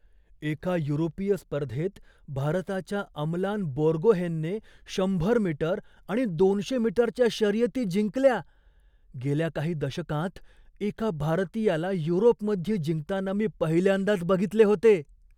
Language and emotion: Marathi, surprised